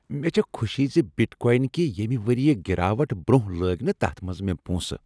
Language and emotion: Kashmiri, happy